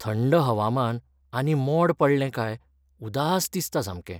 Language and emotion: Goan Konkani, sad